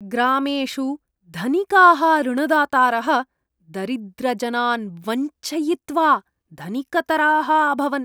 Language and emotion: Sanskrit, disgusted